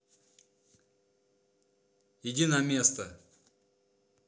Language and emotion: Russian, angry